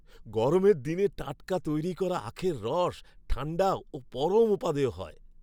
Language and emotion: Bengali, happy